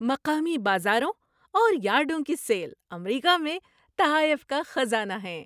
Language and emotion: Urdu, happy